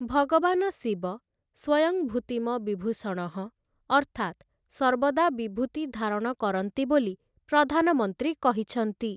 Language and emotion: Odia, neutral